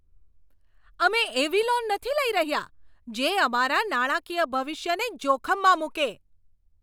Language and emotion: Gujarati, angry